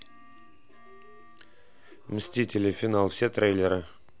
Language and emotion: Russian, neutral